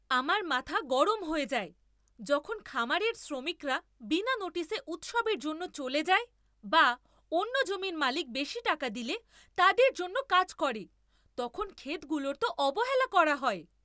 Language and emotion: Bengali, angry